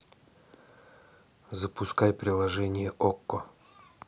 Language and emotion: Russian, neutral